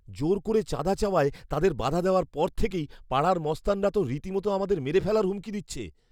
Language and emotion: Bengali, fearful